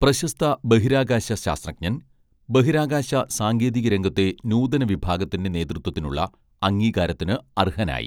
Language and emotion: Malayalam, neutral